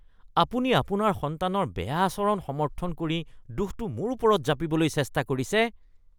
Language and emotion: Assamese, disgusted